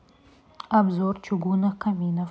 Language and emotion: Russian, neutral